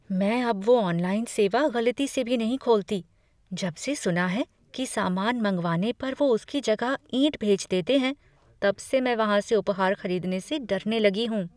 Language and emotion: Hindi, fearful